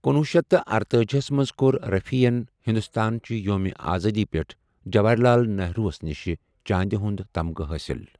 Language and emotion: Kashmiri, neutral